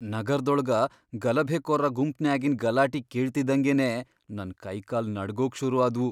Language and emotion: Kannada, fearful